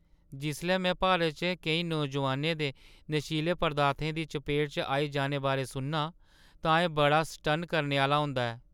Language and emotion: Dogri, sad